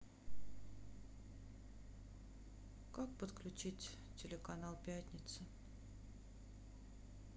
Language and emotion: Russian, sad